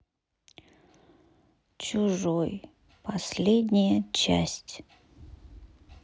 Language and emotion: Russian, sad